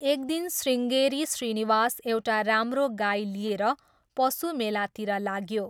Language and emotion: Nepali, neutral